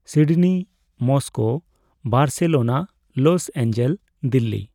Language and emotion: Santali, neutral